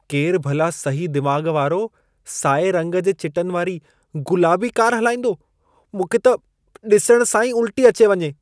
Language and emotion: Sindhi, disgusted